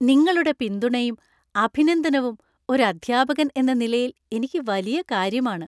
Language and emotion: Malayalam, happy